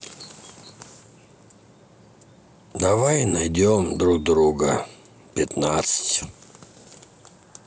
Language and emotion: Russian, sad